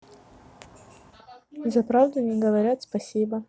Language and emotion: Russian, neutral